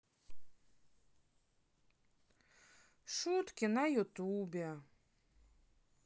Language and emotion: Russian, sad